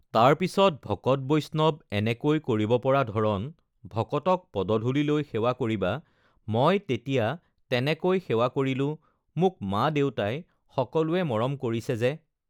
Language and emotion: Assamese, neutral